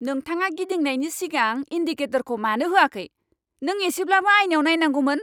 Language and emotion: Bodo, angry